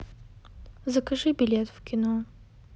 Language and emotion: Russian, sad